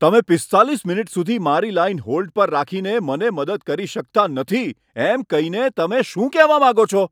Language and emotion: Gujarati, angry